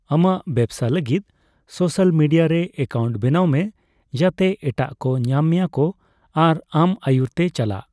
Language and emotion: Santali, neutral